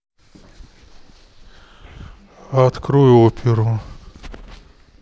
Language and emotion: Russian, sad